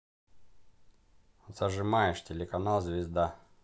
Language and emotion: Russian, neutral